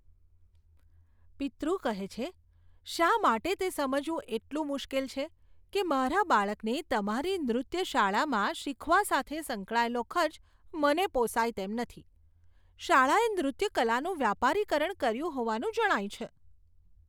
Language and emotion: Gujarati, disgusted